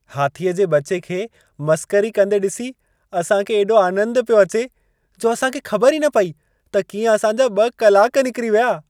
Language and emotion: Sindhi, happy